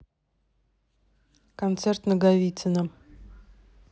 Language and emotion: Russian, neutral